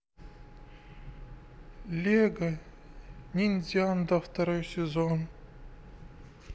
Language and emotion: Russian, sad